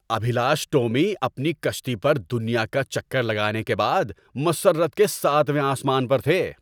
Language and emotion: Urdu, happy